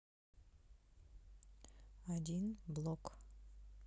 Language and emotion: Russian, neutral